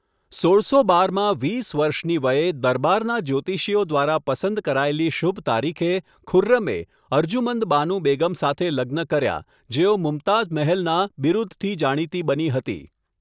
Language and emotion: Gujarati, neutral